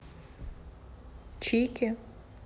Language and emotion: Russian, neutral